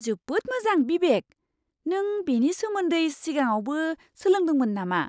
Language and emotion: Bodo, surprised